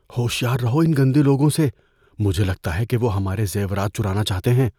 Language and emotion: Urdu, fearful